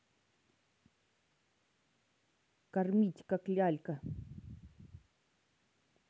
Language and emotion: Russian, neutral